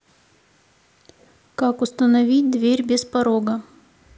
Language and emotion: Russian, neutral